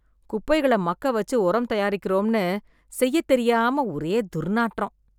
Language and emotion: Tamil, disgusted